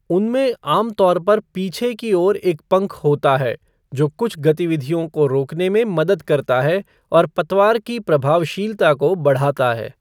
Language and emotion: Hindi, neutral